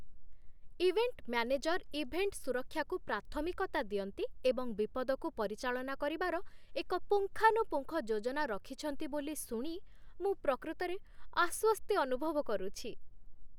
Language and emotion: Odia, happy